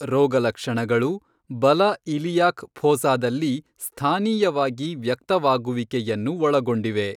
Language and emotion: Kannada, neutral